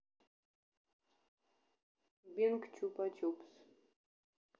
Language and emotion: Russian, neutral